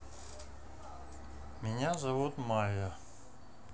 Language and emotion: Russian, neutral